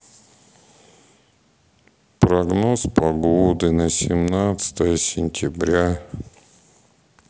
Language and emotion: Russian, sad